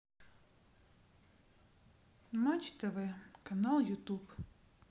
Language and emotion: Russian, sad